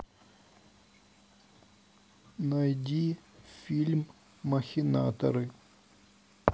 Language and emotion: Russian, neutral